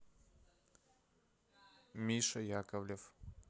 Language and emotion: Russian, neutral